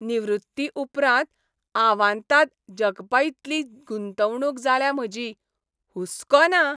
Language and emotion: Goan Konkani, happy